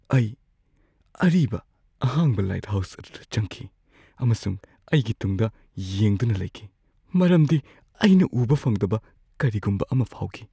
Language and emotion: Manipuri, fearful